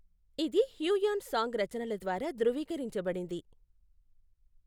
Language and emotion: Telugu, neutral